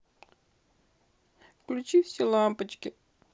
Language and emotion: Russian, sad